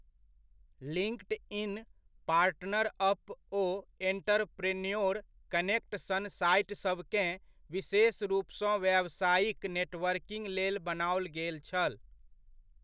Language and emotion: Maithili, neutral